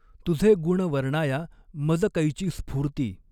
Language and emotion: Marathi, neutral